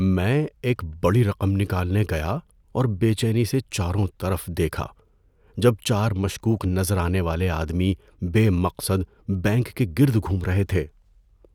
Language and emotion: Urdu, fearful